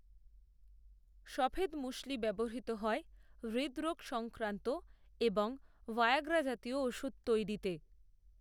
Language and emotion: Bengali, neutral